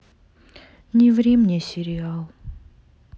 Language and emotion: Russian, sad